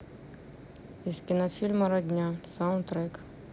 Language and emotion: Russian, neutral